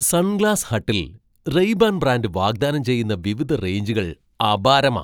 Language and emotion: Malayalam, surprised